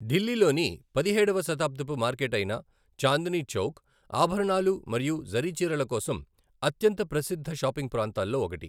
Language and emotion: Telugu, neutral